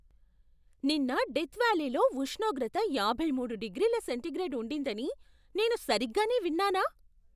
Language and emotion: Telugu, surprised